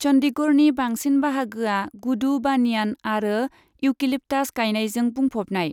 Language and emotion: Bodo, neutral